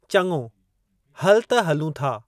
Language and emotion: Sindhi, neutral